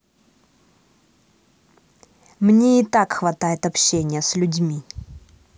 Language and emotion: Russian, angry